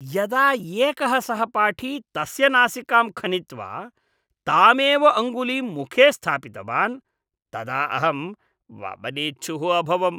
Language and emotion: Sanskrit, disgusted